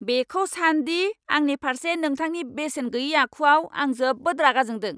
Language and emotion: Bodo, angry